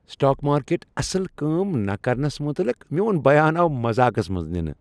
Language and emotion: Kashmiri, happy